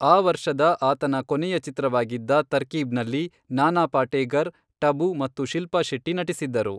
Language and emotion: Kannada, neutral